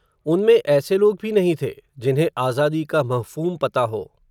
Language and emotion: Hindi, neutral